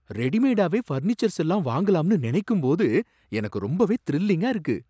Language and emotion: Tamil, surprised